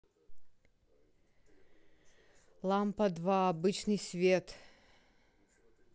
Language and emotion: Russian, neutral